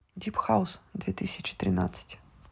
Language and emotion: Russian, neutral